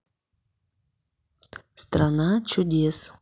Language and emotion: Russian, neutral